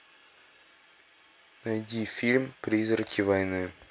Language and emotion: Russian, neutral